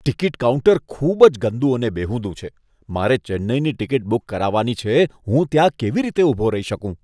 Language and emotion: Gujarati, disgusted